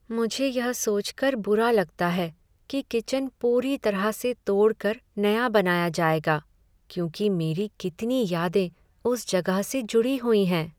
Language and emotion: Hindi, sad